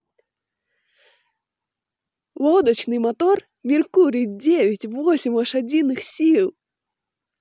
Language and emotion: Russian, positive